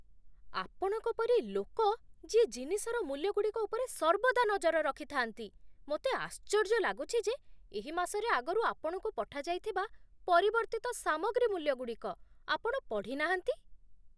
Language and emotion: Odia, surprised